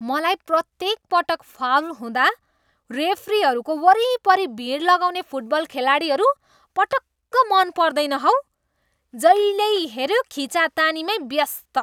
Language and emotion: Nepali, disgusted